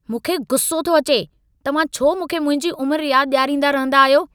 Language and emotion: Sindhi, angry